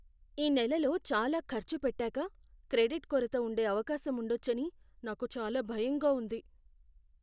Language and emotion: Telugu, fearful